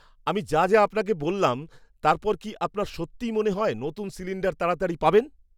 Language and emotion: Bengali, surprised